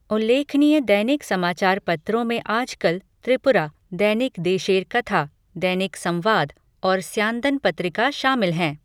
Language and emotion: Hindi, neutral